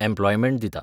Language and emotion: Goan Konkani, neutral